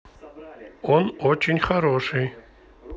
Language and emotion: Russian, neutral